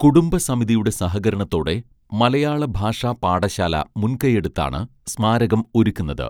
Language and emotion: Malayalam, neutral